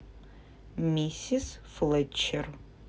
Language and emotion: Russian, neutral